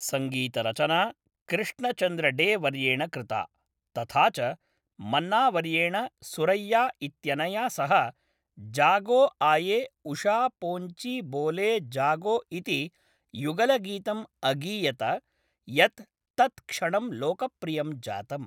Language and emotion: Sanskrit, neutral